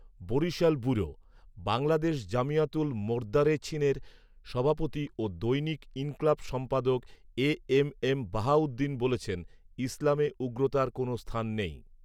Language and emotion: Bengali, neutral